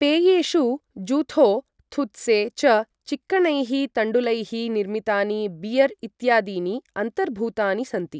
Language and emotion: Sanskrit, neutral